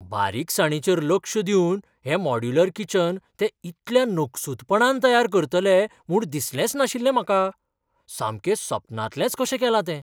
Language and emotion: Goan Konkani, surprised